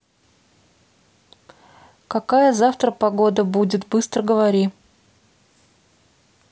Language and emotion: Russian, neutral